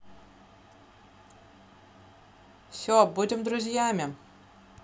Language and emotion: Russian, neutral